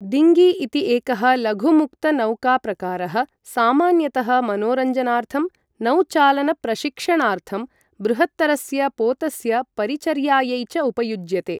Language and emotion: Sanskrit, neutral